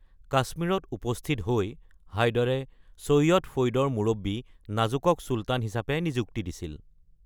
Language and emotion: Assamese, neutral